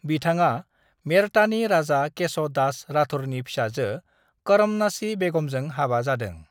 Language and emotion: Bodo, neutral